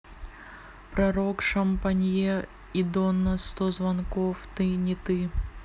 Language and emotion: Russian, neutral